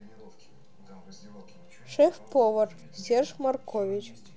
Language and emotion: Russian, neutral